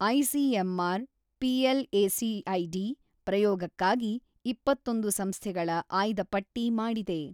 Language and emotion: Kannada, neutral